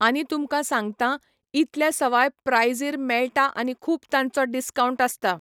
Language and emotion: Goan Konkani, neutral